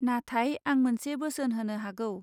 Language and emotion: Bodo, neutral